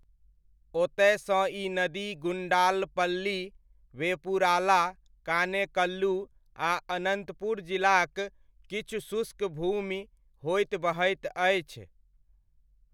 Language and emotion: Maithili, neutral